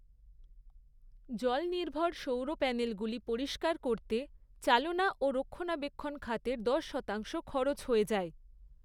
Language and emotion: Bengali, neutral